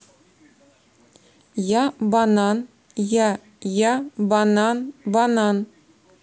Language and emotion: Russian, neutral